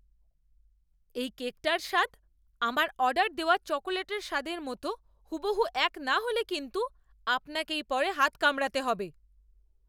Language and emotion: Bengali, angry